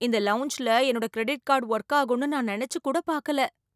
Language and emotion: Tamil, surprised